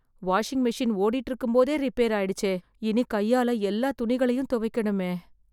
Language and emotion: Tamil, sad